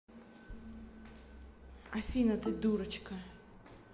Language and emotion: Russian, neutral